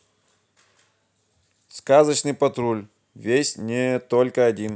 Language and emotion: Russian, neutral